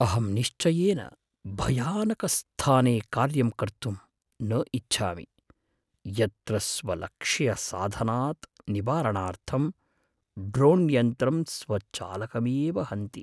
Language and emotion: Sanskrit, fearful